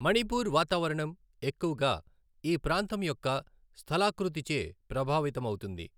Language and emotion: Telugu, neutral